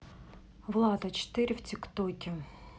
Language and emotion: Russian, neutral